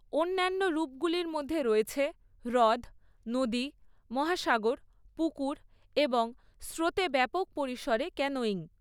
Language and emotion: Bengali, neutral